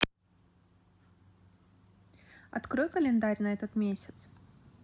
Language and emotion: Russian, neutral